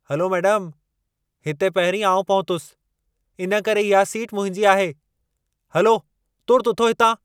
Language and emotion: Sindhi, angry